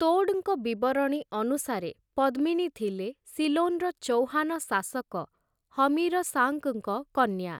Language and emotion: Odia, neutral